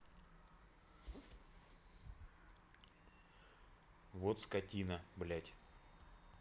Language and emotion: Russian, angry